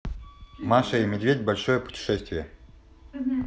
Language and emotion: Russian, neutral